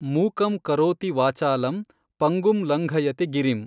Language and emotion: Kannada, neutral